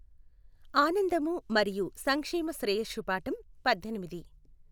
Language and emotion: Telugu, neutral